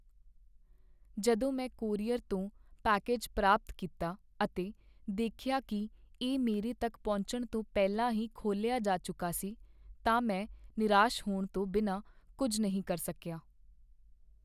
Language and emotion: Punjabi, sad